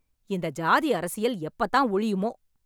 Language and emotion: Tamil, angry